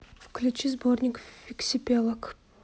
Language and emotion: Russian, neutral